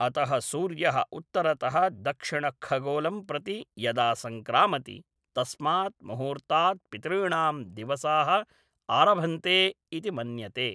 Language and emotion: Sanskrit, neutral